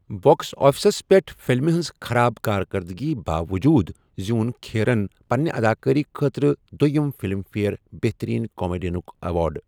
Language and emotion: Kashmiri, neutral